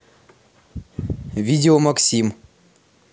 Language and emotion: Russian, neutral